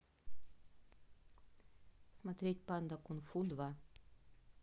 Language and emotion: Russian, neutral